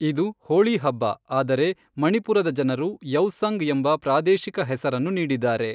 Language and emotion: Kannada, neutral